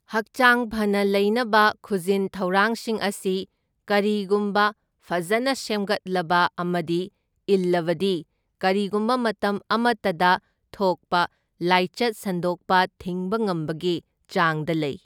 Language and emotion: Manipuri, neutral